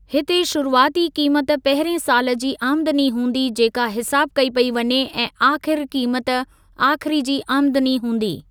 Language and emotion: Sindhi, neutral